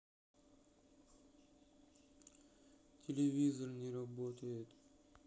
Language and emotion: Russian, sad